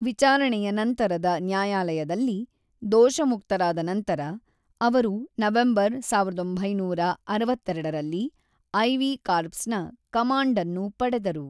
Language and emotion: Kannada, neutral